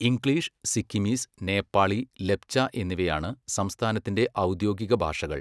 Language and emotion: Malayalam, neutral